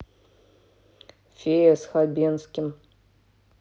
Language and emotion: Russian, neutral